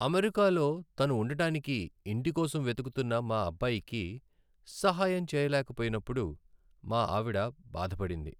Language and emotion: Telugu, sad